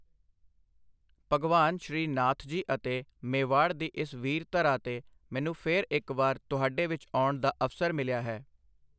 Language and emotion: Punjabi, neutral